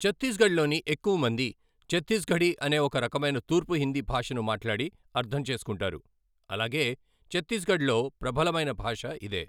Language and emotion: Telugu, neutral